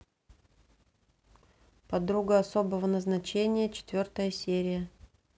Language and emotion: Russian, neutral